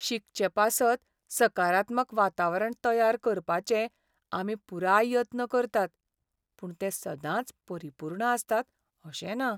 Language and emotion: Goan Konkani, sad